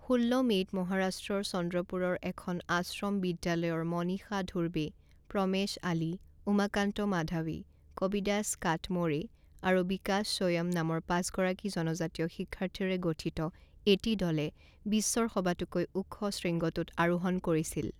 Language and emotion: Assamese, neutral